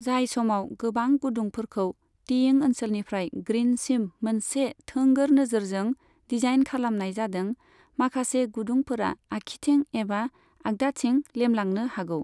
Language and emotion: Bodo, neutral